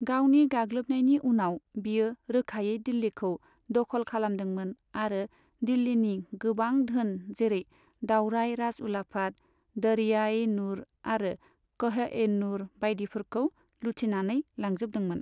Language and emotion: Bodo, neutral